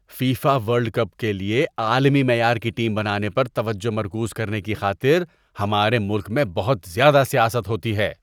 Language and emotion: Urdu, disgusted